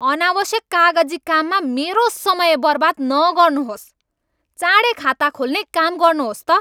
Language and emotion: Nepali, angry